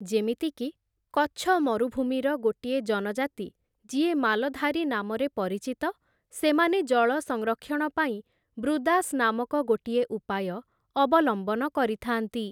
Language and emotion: Odia, neutral